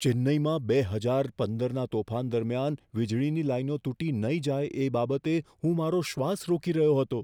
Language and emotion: Gujarati, fearful